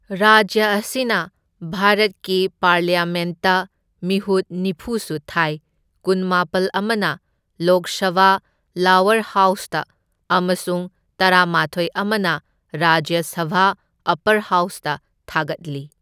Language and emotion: Manipuri, neutral